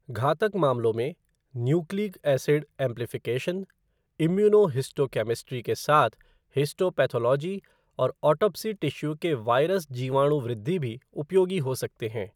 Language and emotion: Hindi, neutral